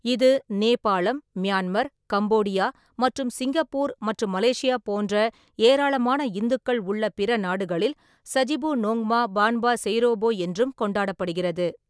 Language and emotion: Tamil, neutral